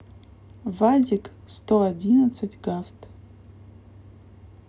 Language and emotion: Russian, neutral